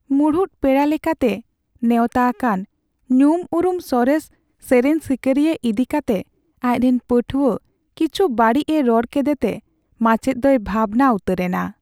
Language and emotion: Santali, sad